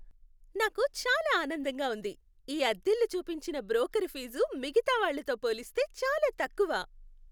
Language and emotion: Telugu, happy